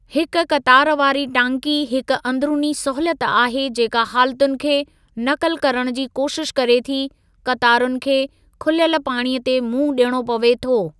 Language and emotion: Sindhi, neutral